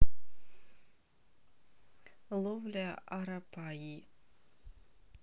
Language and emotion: Russian, neutral